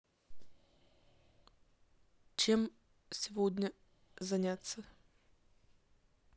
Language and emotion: Russian, neutral